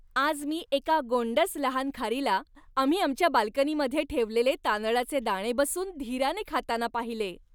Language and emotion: Marathi, happy